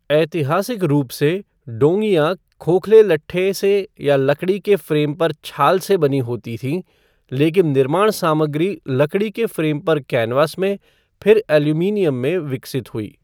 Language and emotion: Hindi, neutral